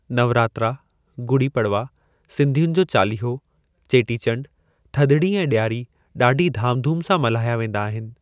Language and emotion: Sindhi, neutral